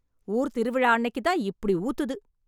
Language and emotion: Tamil, angry